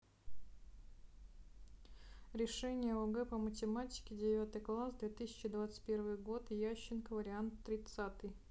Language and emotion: Russian, neutral